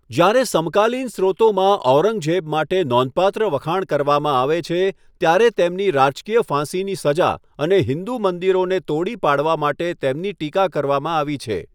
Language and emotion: Gujarati, neutral